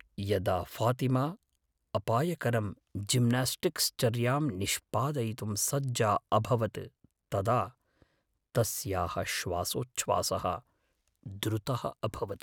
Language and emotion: Sanskrit, fearful